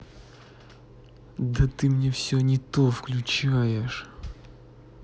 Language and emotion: Russian, angry